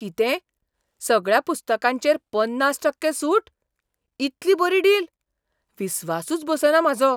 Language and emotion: Goan Konkani, surprised